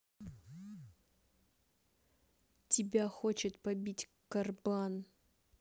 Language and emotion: Russian, angry